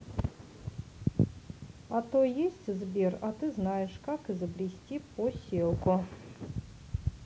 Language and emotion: Russian, neutral